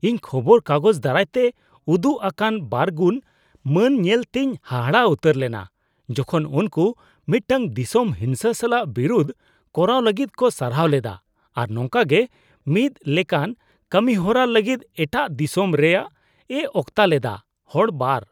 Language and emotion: Santali, disgusted